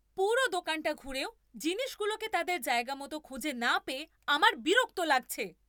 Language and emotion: Bengali, angry